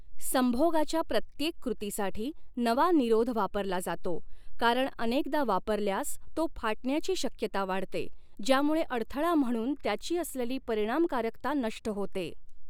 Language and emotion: Marathi, neutral